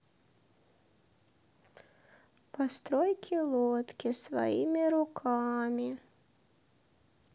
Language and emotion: Russian, sad